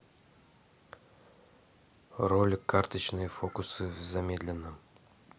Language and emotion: Russian, neutral